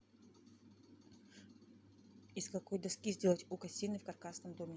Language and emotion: Russian, neutral